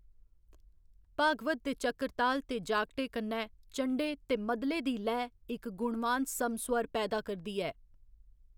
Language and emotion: Dogri, neutral